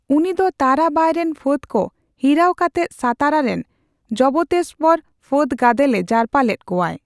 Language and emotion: Santali, neutral